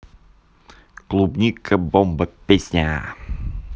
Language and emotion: Russian, positive